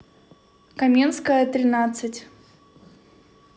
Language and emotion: Russian, neutral